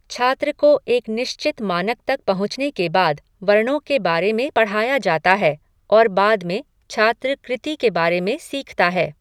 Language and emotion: Hindi, neutral